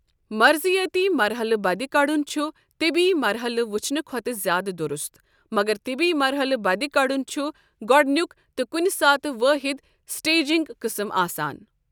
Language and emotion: Kashmiri, neutral